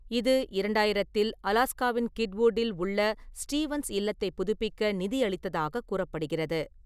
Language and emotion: Tamil, neutral